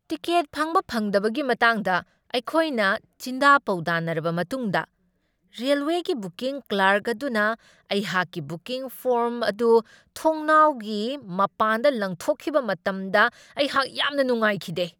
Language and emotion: Manipuri, angry